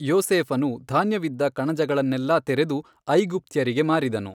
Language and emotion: Kannada, neutral